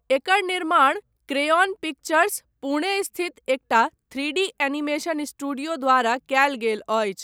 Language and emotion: Maithili, neutral